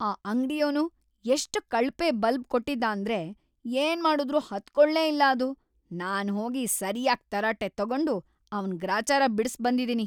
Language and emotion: Kannada, angry